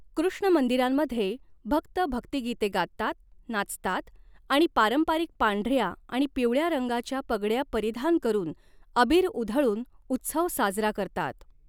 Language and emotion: Marathi, neutral